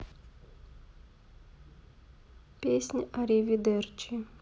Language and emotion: Russian, sad